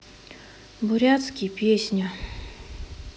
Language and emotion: Russian, sad